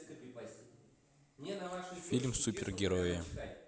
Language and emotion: Russian, neutral